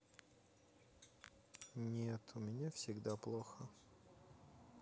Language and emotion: Russian, sad